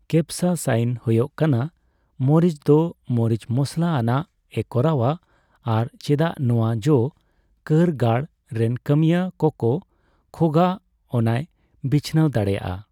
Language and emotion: Santali, neutral